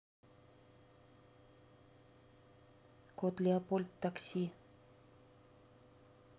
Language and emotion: Russian, neutral